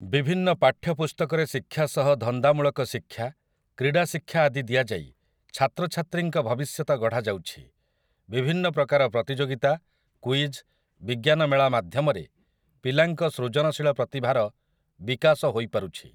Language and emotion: Odia, neutral